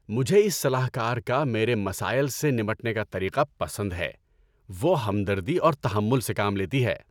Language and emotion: Urdu, happy